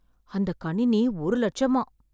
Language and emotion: Tamil, surprised